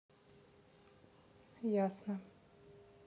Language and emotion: Russian, neutral